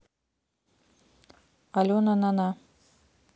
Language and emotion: Russian, neutral